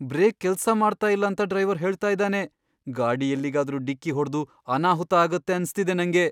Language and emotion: Kannada, fearful